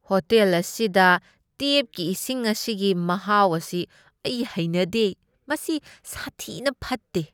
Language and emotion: Manipuri, disgusted